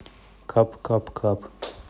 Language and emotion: Russian, neutral